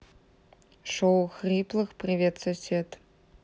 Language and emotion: Russian, neutral